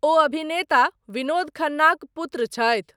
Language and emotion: Maithili, neutral